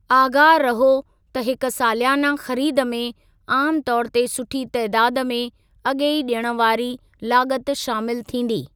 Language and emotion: Sindhi, neutral